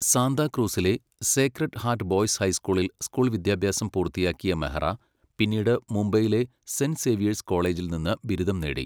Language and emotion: Malayalam, neutral